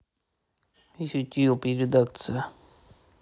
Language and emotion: Russian, neutral